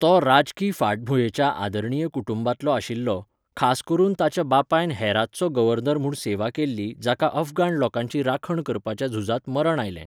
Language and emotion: Goan Konkani, neutral